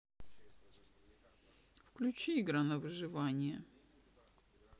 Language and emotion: Russian, neutral